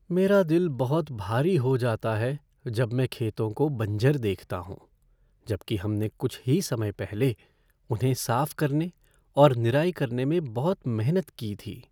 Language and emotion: Hindi, sad